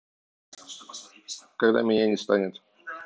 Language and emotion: Russian, neutral